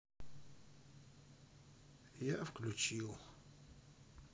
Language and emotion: Russian, sad